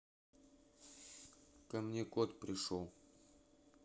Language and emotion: Russian, neutral